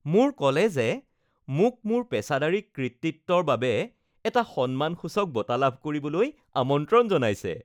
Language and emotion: Assamese, happy